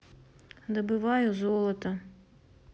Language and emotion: Russian, neutral